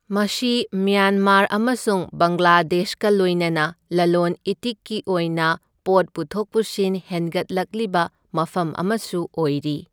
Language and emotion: Manipuri, neutral